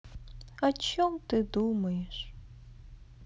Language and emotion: Russian, sad